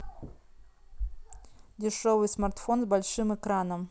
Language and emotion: Russian, neutral